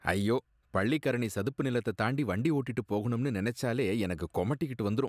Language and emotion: Tamil, disgusted